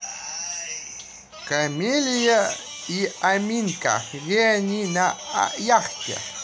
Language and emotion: Russian, neutral